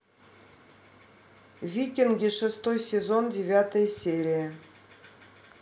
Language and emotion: Russian, neutral